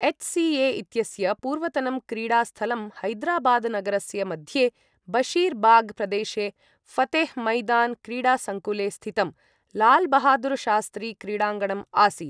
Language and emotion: Sanskrit, neutral